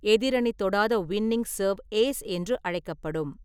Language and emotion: Tamil, neutral